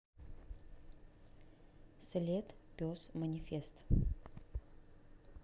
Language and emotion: Russian, neutral